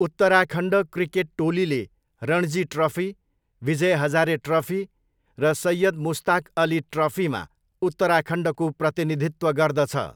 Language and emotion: Nepali, neutral